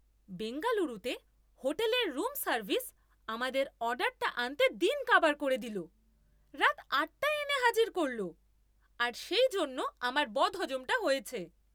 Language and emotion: Bengali, angry